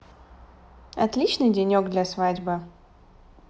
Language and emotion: Russian, positive